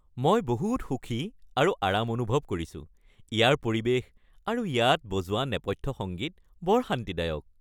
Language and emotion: Assamese, happy